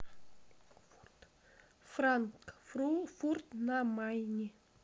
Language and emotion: Russian, neutral